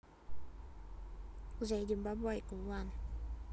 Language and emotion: Russian, neutral